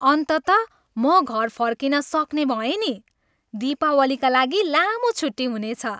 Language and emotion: Nepali, happy